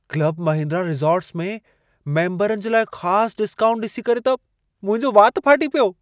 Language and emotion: Sindhi, surprised